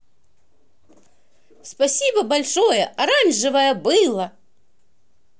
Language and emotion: Russian, positive